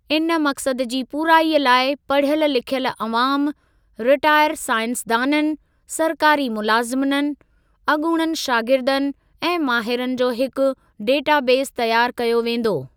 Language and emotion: Sindhi, neutral